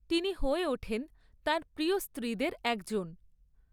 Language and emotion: Bengali, neutral